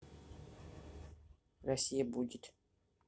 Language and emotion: Russian, neutral